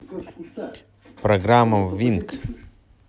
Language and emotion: Russian, neutral